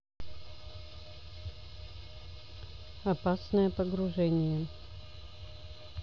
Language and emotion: Russian, neutral